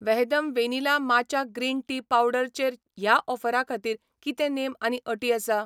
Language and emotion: Goan Konkani, neutral